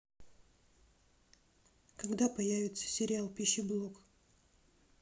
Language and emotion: Russian, neutral